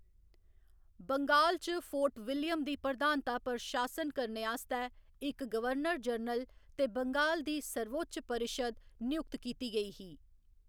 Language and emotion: Dogri, neutral